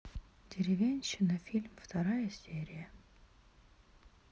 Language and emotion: Russian, sad